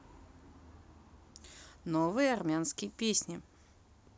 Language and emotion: Russian, neutral